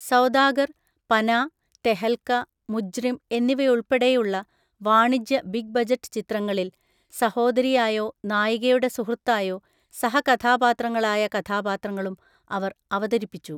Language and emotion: Malayalam, neutral